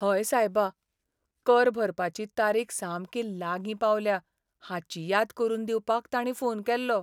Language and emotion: Goan Konkani, sad